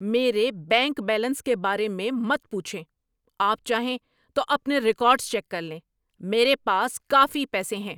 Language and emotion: Urdu, angry